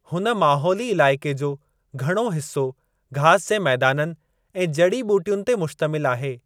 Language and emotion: Sindhi, neutral